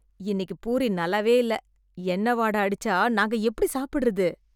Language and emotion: Tamil, disgusted